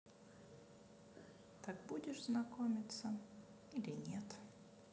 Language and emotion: Russian, sad